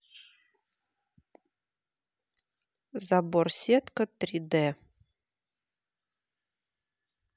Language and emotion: Russian, neutral